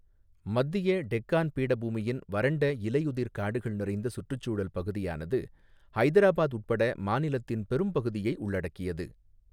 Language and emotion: Tamil, neutral